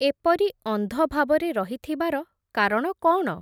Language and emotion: Odia, neutral